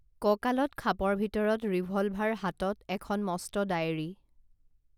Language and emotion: Assamese, neutral